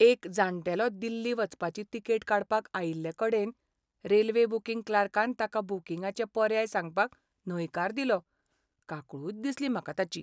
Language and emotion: Goan Konkani, sad